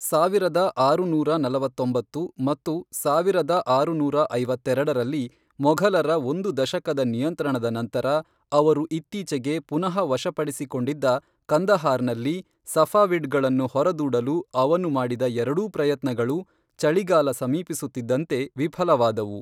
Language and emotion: Kannada, neutral